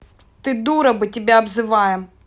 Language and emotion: Russian, angry